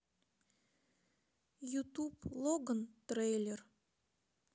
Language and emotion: Russian, sad